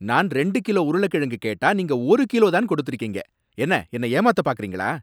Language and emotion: Tamil, angry